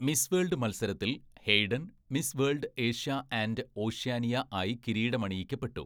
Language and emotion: Malayalam, neutral